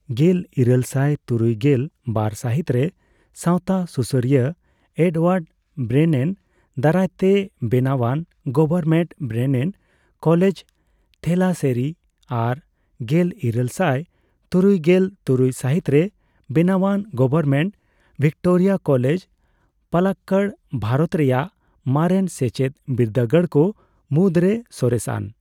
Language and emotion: Santali, neutral